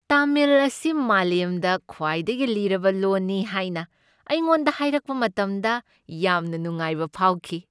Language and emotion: Manipuri, happy